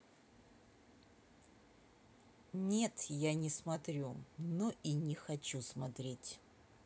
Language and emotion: Russian, neutral